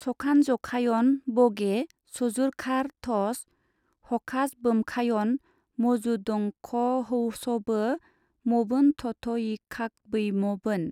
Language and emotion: Bodo, neutral